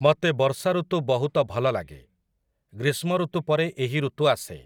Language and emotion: Odia, neutral